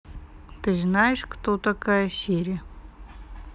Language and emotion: Russian, neutral